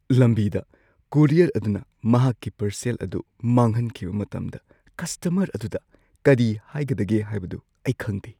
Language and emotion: Manipuri, fearful